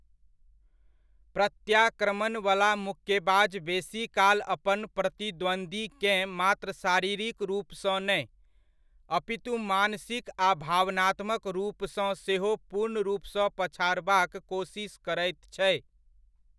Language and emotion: Maithili, neutral